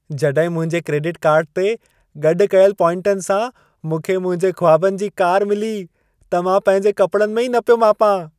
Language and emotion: Sindhi, happy